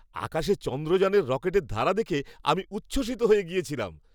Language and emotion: Bengali, happy